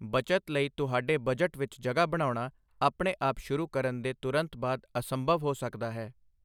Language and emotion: Punjabi, neutral